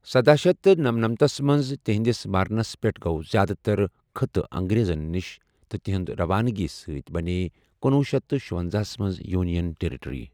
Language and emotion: Kashmiri, neutral